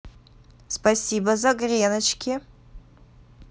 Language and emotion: Russian, positive